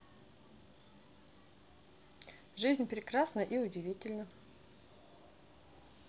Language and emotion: Russian, neutral